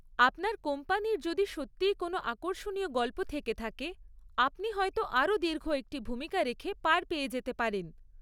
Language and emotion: Bengali, neutral